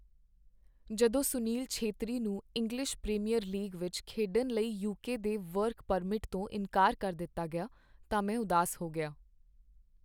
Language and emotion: Punjabi, sad